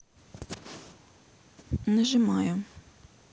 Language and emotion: Russian, neutral